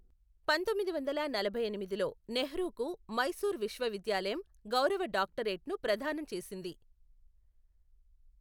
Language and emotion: Telugu, neutral